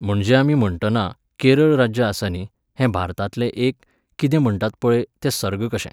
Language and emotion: Goan Konkani, neutral